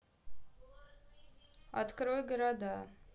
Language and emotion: Russian, neutral